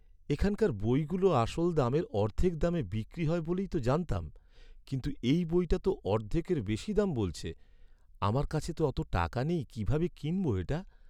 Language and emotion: Bengali, sad